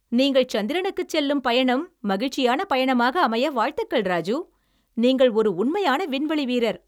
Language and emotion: Tamil, happy